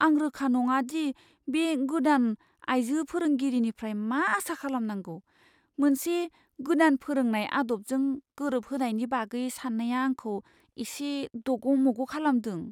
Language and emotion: Bodo, fearful